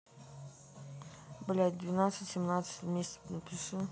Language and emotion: Russian, neutral